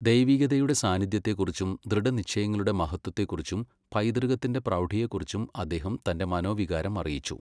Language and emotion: Malayalam, neutral